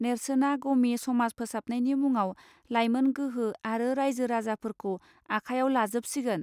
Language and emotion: Bodo, neutral